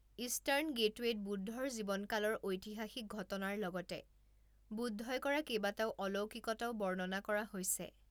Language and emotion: Assamese, neutral